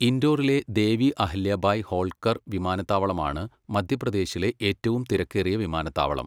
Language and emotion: Malayalam, neutral